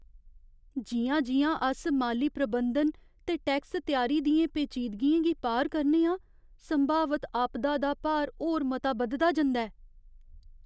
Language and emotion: Dogri, fearful